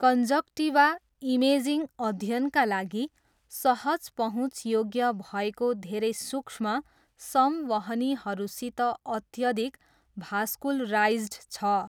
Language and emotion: Nepali, neutral